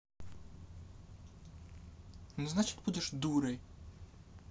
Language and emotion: Russian, angry